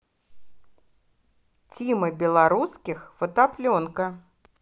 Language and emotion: Russian, positive